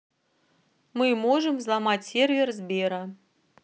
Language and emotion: Russian, neutral